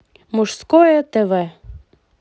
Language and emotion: Russian, positive